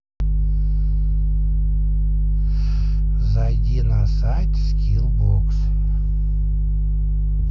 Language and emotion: Russian, neutral